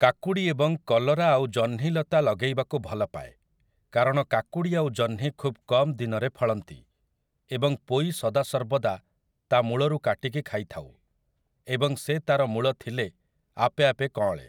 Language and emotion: Odia, neutral